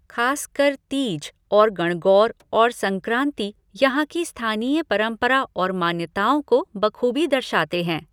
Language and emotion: Hindi, neutral